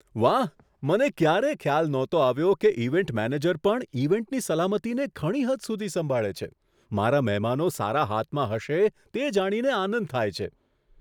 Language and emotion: Gujarati, surprised